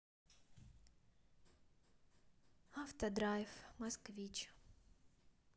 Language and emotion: Russian, sad